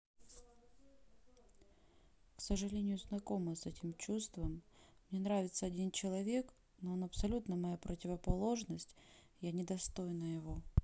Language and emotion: Russian, sad